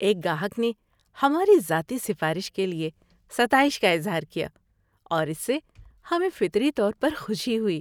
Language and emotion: Urdu, happy